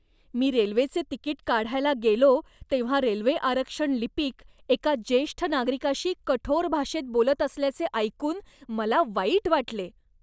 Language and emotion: Marathi, disgusted